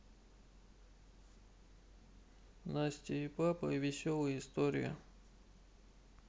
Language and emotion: Russian, neutral